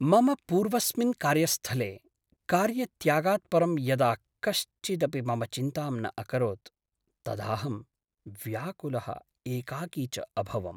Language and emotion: Sanskrit, sad